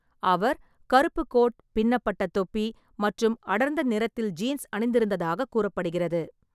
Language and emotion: Tamil, neutral